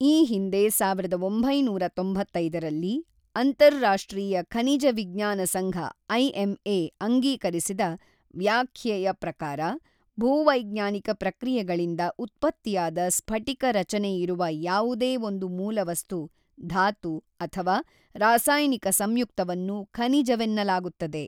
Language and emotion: Kannada, neutral